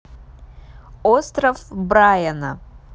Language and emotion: Russian, neutral